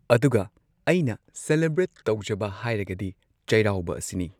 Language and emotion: Manipuri, neutral